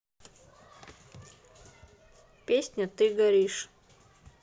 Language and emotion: Russian, neutral